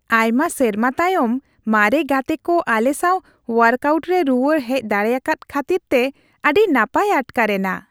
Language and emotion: Santali, happy